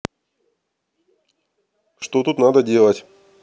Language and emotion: Russian, neutral